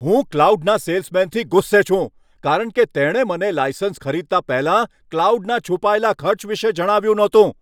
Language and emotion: Gujarati, angry